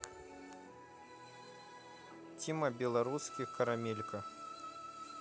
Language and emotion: Russian, neutral